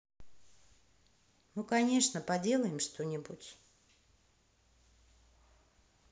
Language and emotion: Russian, neutral